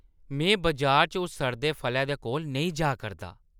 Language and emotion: Dogri, disgusted